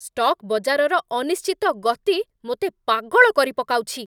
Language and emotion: Odia, angry